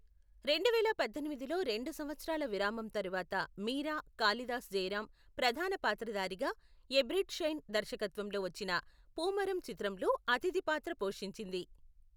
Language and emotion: Telugu, neutral